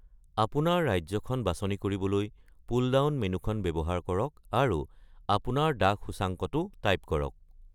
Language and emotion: Assamese, neutral